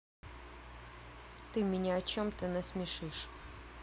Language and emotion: Russian, neutral